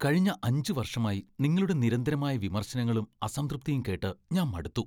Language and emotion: Malayalam, disgusted